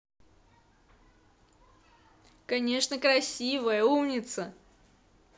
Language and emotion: Russian, positive